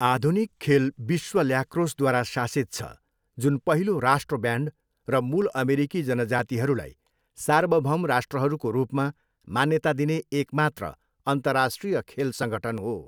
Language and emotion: Nepali, neutral